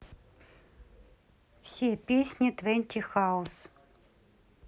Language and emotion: Russian, neutral